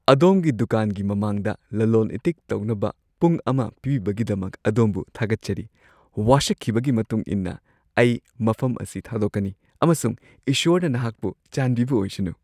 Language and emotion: Manipuri, happy